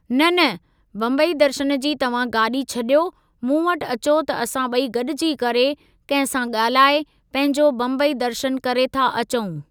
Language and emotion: Sindhi, neutral